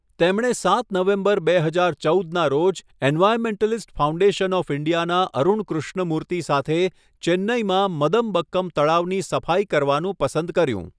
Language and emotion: Gujarati, neutral